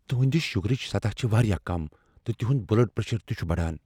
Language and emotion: Kashmiri, fearful